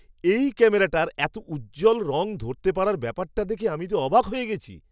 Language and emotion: Bengali, surprised